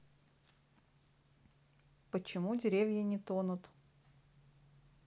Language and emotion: Russian, neutral